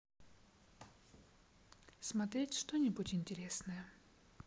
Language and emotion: Russian, neutral